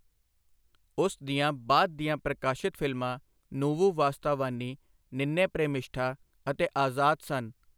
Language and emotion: Punjabi, neutral